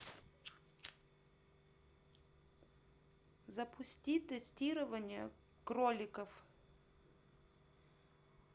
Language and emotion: Russian, neutral